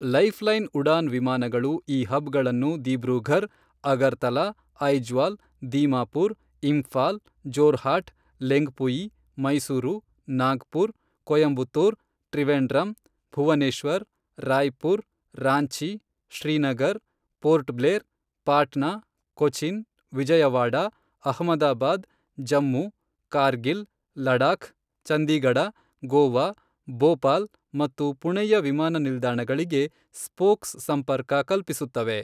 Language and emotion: Kannada, neutral